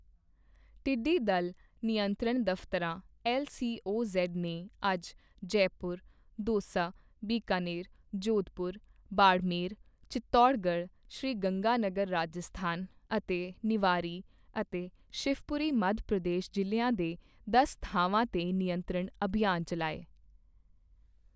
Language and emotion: Punjabi, neutral